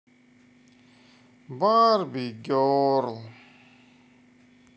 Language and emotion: Russian, sad